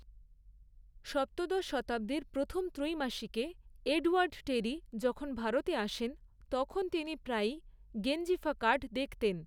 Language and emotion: Bengali, neutral